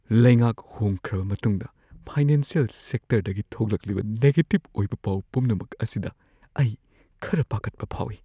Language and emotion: Manipuri, fearful